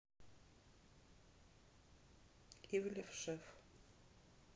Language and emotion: Russian, neutral